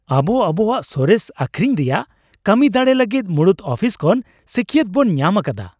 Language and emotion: Santali, happy